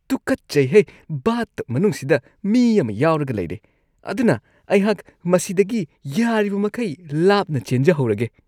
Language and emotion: Manipuri, disgusted